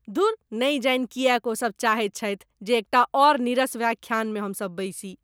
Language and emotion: Maithili, disgusted